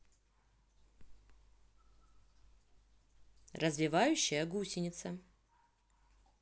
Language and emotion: Russian, neutral